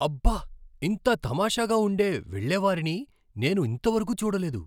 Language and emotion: Telugu, surprised